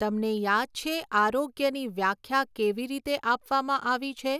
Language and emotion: Gujarati, neutral